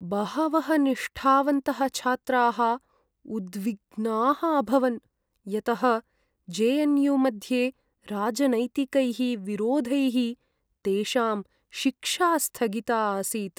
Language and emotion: Sanskrit, sad